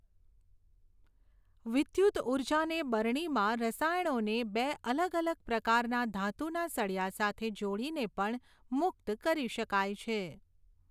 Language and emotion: Gujarati, neutral